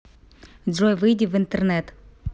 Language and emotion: Russian, neutral